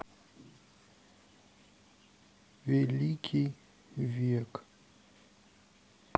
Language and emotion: Russian, neutral